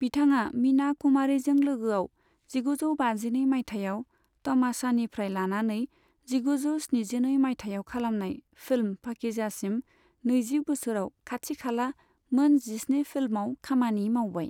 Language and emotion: Bodo, neutral